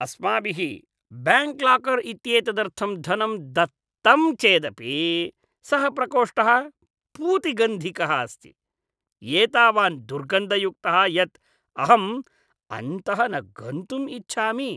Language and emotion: Sanskrit, disgusted